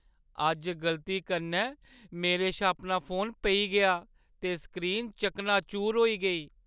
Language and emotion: Dogri, sad